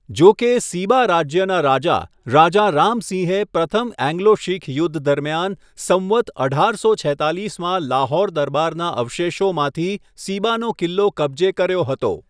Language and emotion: Gujarati, neutral